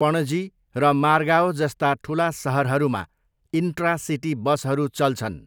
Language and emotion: Nepali, neutral